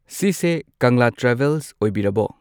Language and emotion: Manipuri, neutral